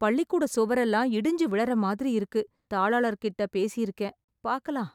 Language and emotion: Tamil, sad